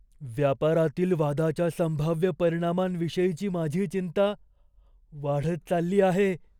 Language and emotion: Marathi, fearful